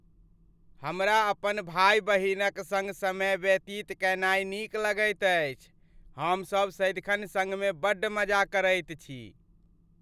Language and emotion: Maithili, happy